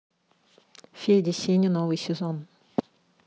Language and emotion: Russian, neutral